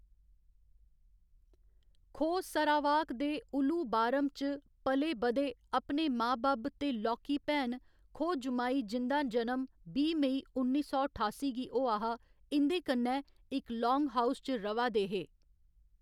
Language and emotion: Dogri, neutral